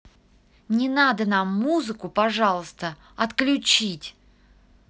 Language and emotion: Russian, angry